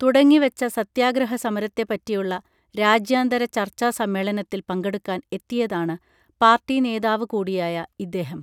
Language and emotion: Malayalam, neutral